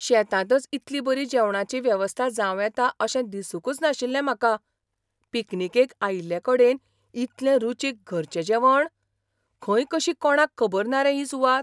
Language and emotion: Goan Konkani, surprised